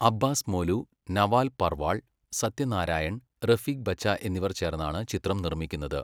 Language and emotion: Malayalam, neutral